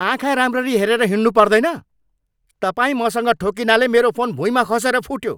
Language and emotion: Nepali, angry